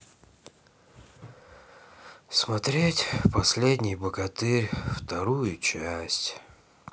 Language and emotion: Russian, sad